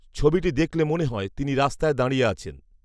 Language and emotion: Bengali, neutral